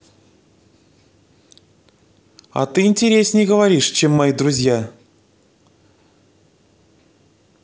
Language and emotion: Russian, positive